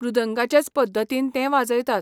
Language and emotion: Goan Konkani, neutral